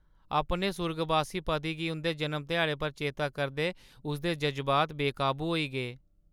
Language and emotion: Dogri, sad